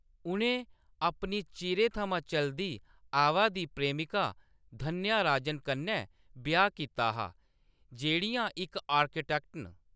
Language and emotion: Dogri, neutral